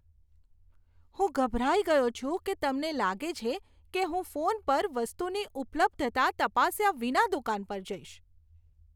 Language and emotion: Gujarati, disgusted